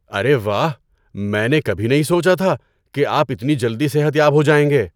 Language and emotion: Urdu, surprised